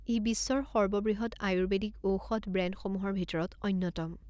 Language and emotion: Assamese, neutral